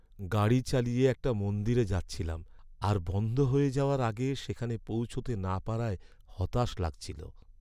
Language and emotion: Bengali, sad